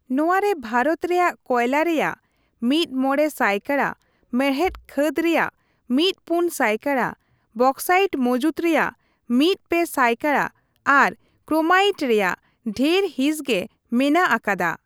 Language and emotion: Santali, neutral